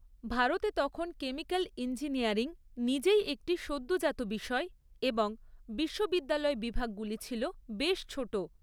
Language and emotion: Bengali, neutral